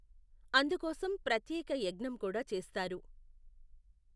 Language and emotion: Telugu, neutral